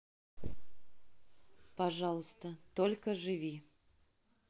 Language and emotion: Russian, neutral